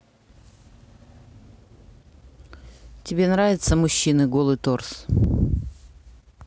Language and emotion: Russian, neutral